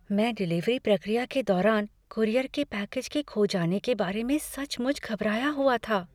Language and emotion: Hindi, fearful